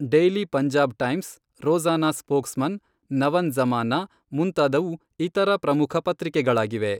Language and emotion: Kannada, neutral